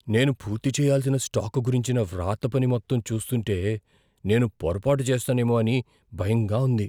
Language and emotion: Telugu, fearful